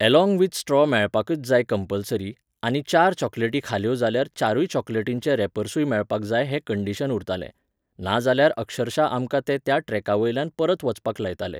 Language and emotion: Goan Konkani, neutral